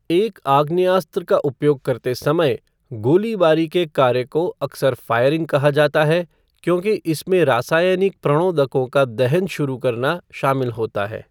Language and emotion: Hindi, neutral